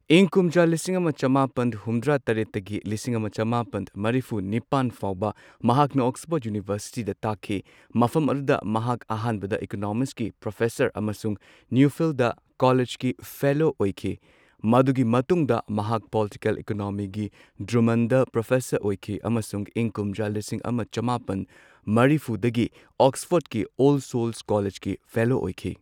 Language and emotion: Manipuri, neutral